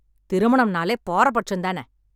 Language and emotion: Tamil, angry